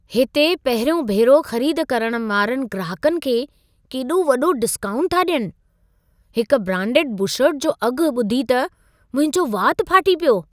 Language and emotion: Sindhi, surprised